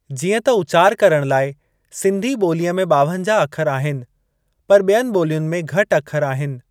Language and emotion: Sindhi, neutral